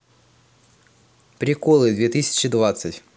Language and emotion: Russian, positive